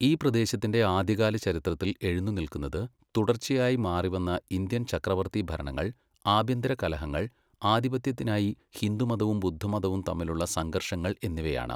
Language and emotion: Malayalam, neutral